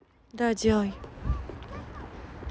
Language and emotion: Russian, neutral